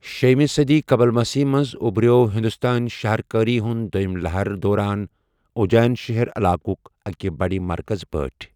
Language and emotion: Kashmiri, neutral